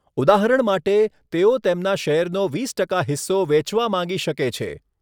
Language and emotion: Gujarati, neutral